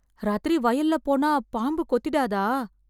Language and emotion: Tamil, fearful